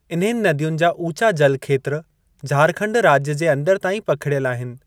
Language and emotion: Sindhi, neutral